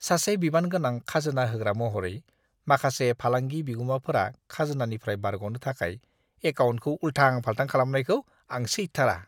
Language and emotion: Bodo, disgusted